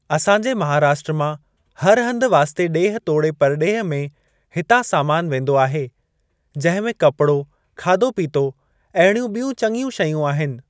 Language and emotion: Sindhi, neutral